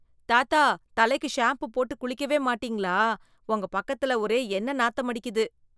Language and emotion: Tamil, disgusted